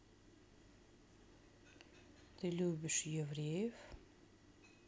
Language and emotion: Russian, neutral